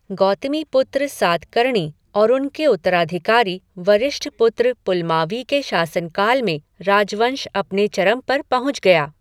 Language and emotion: Hindi, neutral